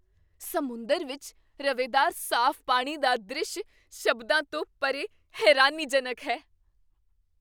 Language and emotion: Punjabi, surprised